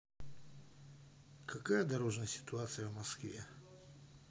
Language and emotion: Russian, neutral